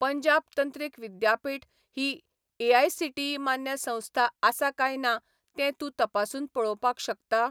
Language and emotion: Goan Konkani, neutral